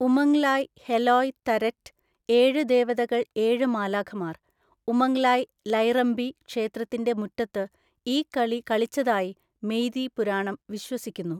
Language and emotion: Malayalam, neutral